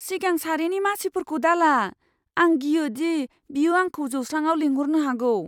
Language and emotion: Bodo, fearful